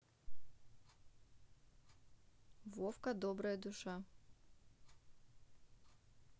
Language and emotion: Russian, neutral